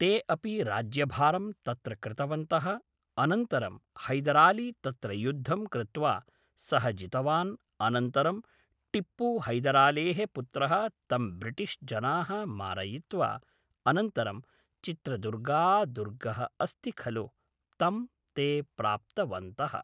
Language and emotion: Sanskrit, neutral